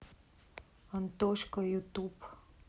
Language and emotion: Russian, sad